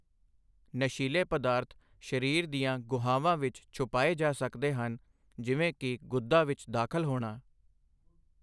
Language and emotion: Punjabi, neutral